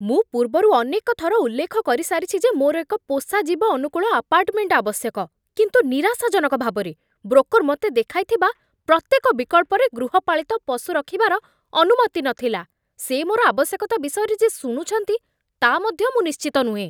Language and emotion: Odia, angry